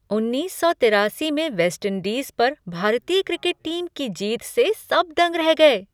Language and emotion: Hindi, surprised